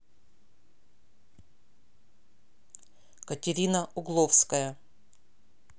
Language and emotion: Russian, neutral